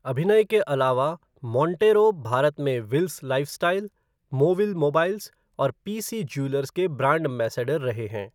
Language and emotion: Hindi, neutral